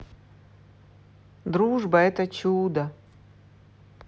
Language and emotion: Russian, positive